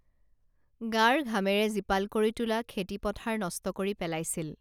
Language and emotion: Assamese, neutral